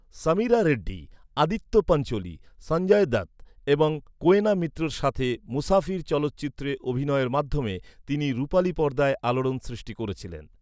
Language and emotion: Bengali, neutral